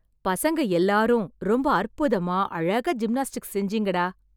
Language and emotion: Tamil, happy